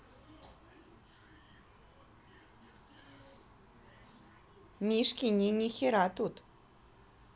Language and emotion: Russian, neutral